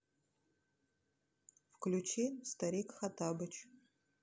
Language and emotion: Russian, neutral